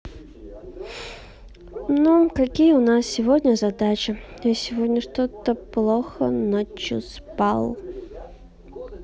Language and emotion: Russian, sad